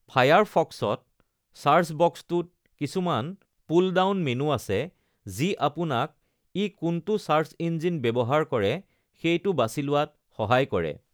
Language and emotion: Assamese, neutral